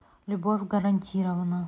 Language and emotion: Russian, neutral